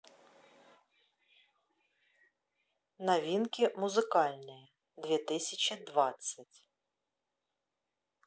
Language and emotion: Russian, neutral